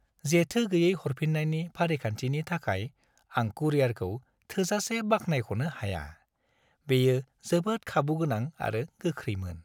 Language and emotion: Bodo, happy